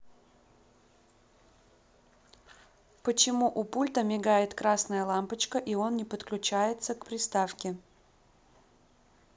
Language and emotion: Russian, neutral